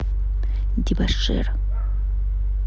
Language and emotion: Russian, neutral